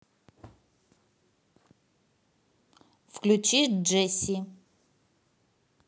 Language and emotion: Russian, neutral